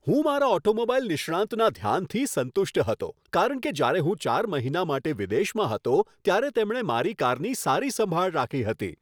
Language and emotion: Gujarati, happy